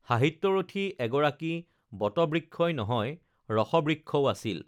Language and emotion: Assamese, neutral